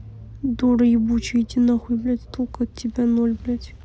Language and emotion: Russian, angry